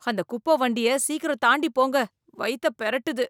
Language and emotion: Tamil, disgusted